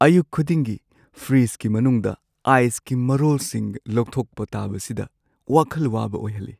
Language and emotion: Manipuri, sad